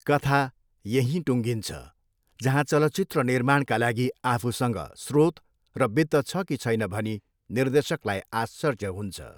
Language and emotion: Nepali, neutral